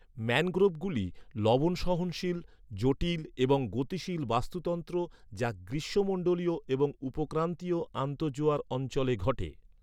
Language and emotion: Bengali, neutral